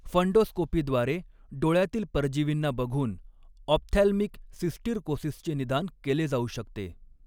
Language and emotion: Marathi, neutral